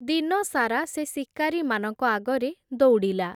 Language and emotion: Odia, neutral